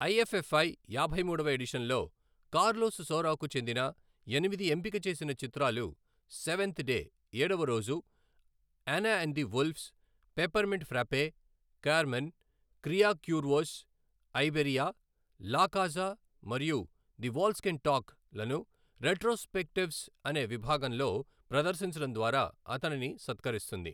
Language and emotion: Telugu, neutral